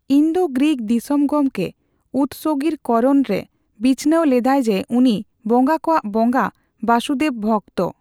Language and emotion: Santali, neutral